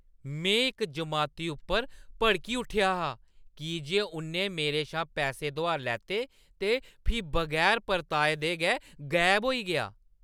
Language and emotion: Dogri, angry